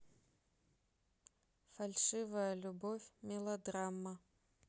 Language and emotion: Russian, neutral